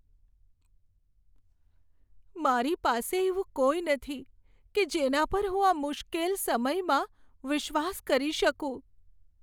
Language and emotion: Gujarati, sad